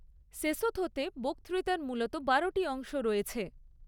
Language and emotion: Bengali, neutral